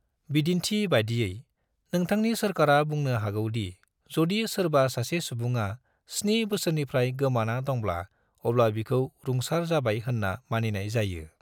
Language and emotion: Bodo, neutral